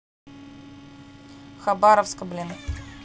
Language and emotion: Russian, neutral